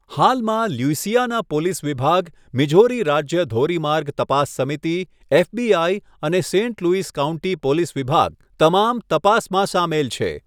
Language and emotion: Gujarati, neutral